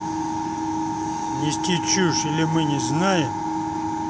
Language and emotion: Russian, angry